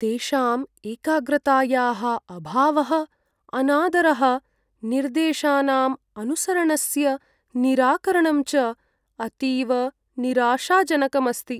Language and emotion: Sanskrit, sad